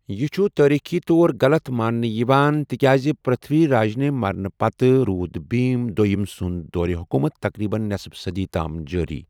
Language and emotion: Kashmiri, neutral